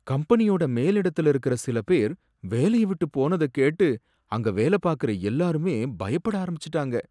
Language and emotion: Tamil, sad